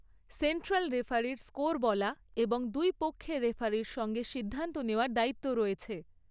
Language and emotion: Bengali, neutral